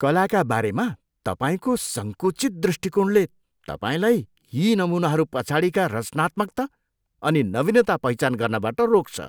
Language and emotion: Nepali, disgusted